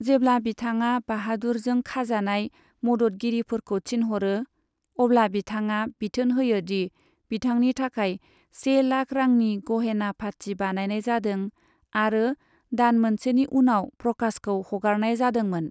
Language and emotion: Bodo, neutral